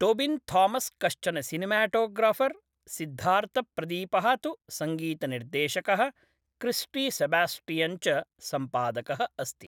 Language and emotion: Sanskrit, neutral